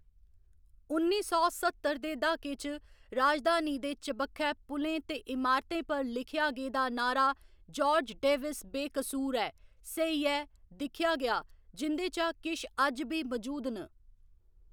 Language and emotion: Dogri, neutral